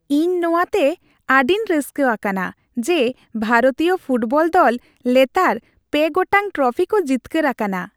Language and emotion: Santali, happy